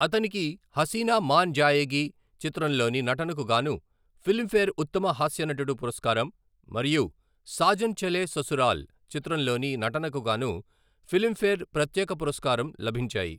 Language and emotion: Telugu, neutral